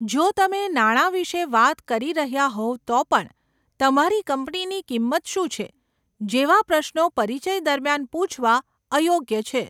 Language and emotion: Gujarati, neutral